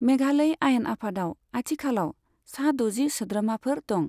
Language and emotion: Bodo, neutral